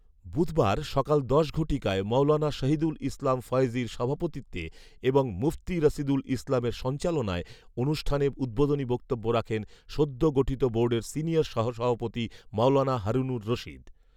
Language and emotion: Bengali, neutral